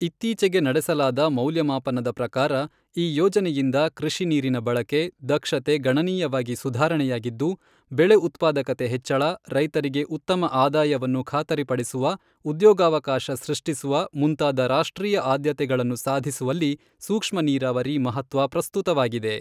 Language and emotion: Kannada, neutral